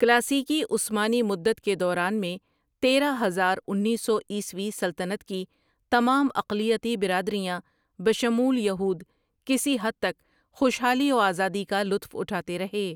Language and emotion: Urdu, neutral